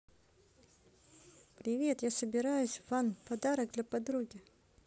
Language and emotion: Russian, positive